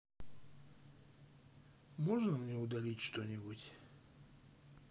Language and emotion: Russian, sad